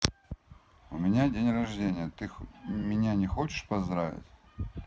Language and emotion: Russian, neutral